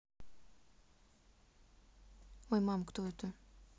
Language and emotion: Russian, neutral